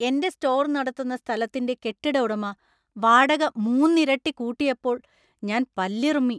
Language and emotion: Malayalam, angry